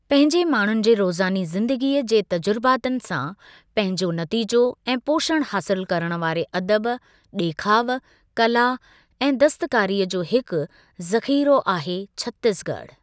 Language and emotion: Sindhi, neutral